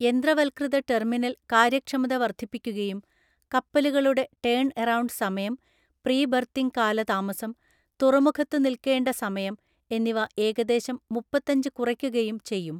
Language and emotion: Malayalam, neutral